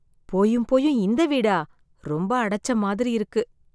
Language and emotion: Tamil, sad